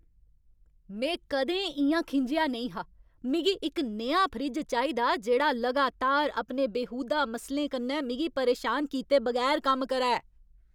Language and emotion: Dogri, angry